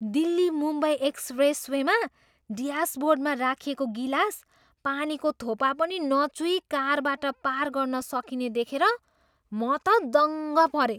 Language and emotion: Nepali, surprised